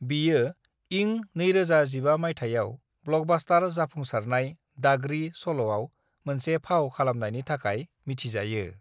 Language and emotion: Bodo, neutral